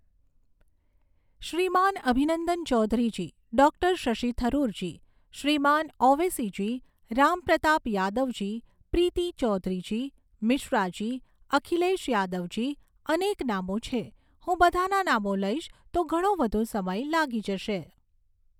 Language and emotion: Gujarati, neutral